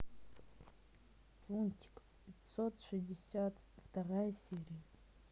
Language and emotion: Russian, neutral